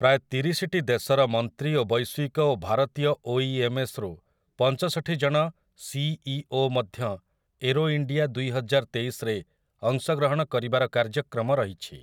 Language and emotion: Odia, neutral